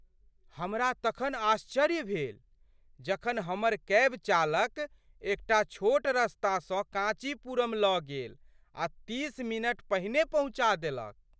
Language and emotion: Maithili, surprised